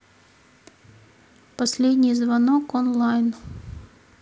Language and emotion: Russian, neutral